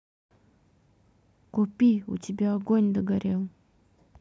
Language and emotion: Russian, neutral